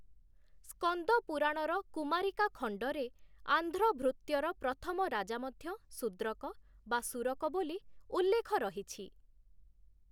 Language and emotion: Odia, neutral